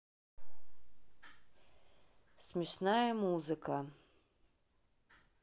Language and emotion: Russian, neutral